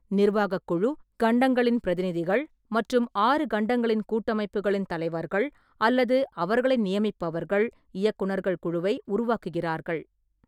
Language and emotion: Tamil, neutral